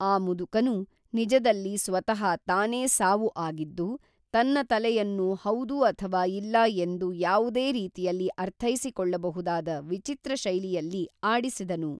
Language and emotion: Kannada, neutral